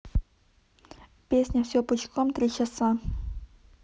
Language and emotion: Russian, neutral